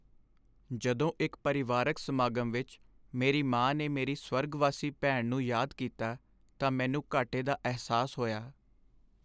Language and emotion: Punjabi, sad